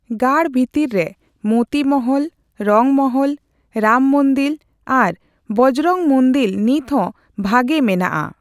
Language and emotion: Santali, neutral